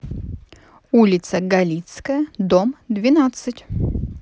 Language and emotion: Russian, neutral